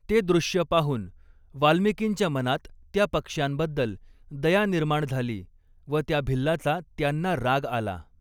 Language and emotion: Marathi, neutral